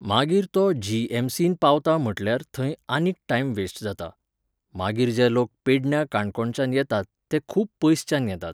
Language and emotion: Goan Konkani, neutral